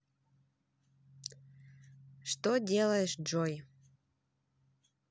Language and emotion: Russian, neutral